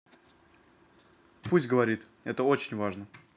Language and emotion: Russian, neutral